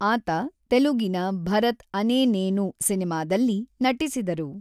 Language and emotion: Kannada, neutral